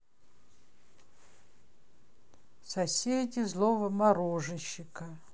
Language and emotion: Russian, sad